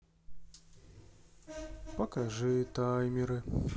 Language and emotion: Russian, sad